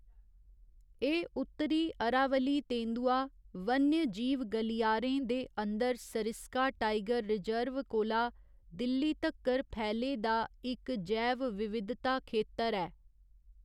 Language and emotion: Dogri, neutral